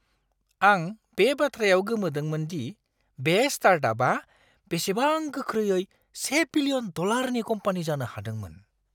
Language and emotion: Bodo, surprised